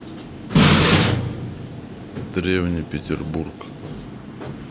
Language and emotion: Russian, neutral